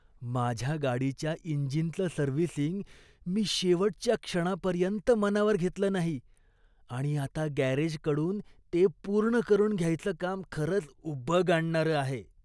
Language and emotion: Marathi, disgusted